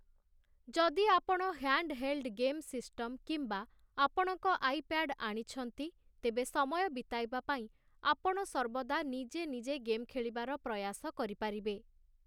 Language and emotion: Odia, neutral